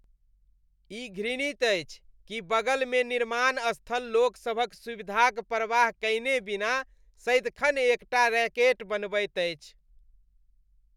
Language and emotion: Maithili, disgusted